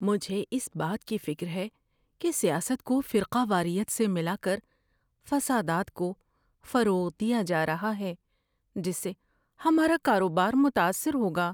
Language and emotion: Urdu, fearful